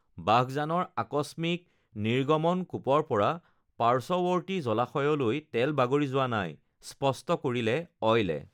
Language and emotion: Assamese, neutral